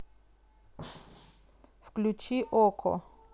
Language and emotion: Russian, neutral